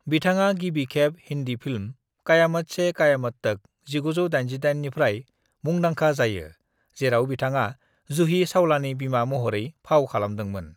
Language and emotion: Bodo, neutral